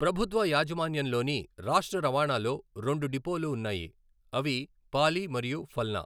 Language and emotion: Telugu, neutral